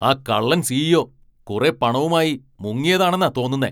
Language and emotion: Malayalam, angry